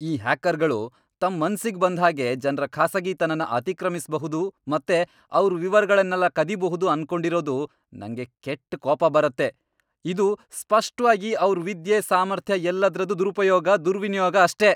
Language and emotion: Kannada, angry